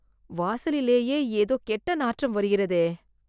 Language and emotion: Tamil, disgusted